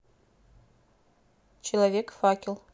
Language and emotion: Russian, neutral